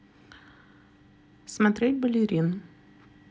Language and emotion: Russian, neutral